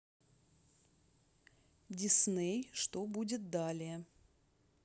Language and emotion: Russian, neutral